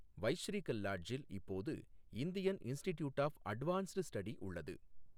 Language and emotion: Tamil, neutral